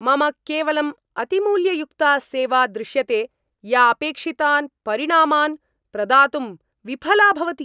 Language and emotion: Sanskrit, angry